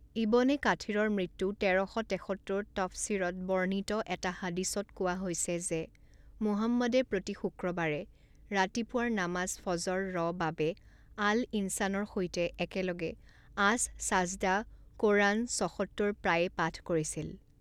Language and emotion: Assamese, neutral